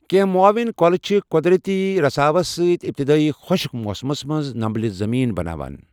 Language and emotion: Kashmiri, neutral